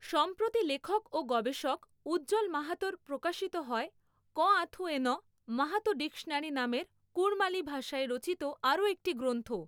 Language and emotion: Bengali, neutral